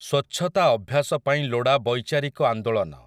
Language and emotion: Odia, neutral